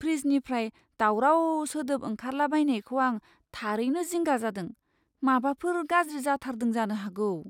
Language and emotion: Bodo, fearful